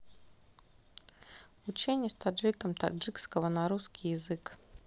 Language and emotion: Russian, neutral